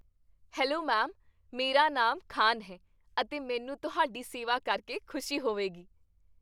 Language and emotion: Punjabi, happy